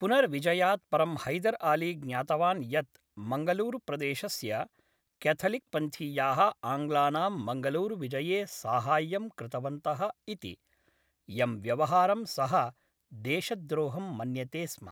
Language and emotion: Sanskrit, neutral